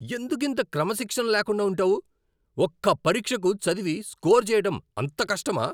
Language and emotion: Telugu, angry